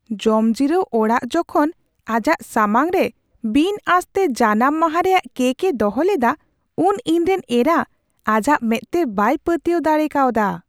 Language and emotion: Santali, surprised